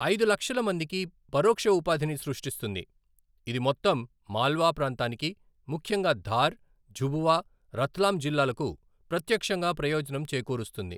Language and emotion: Telugu, neutral